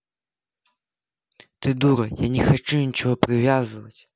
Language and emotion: Russian, angry